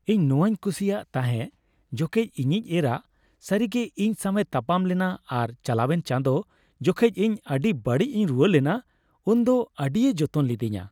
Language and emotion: Santali, happy